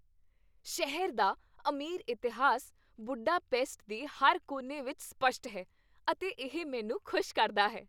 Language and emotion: Punjabi, happy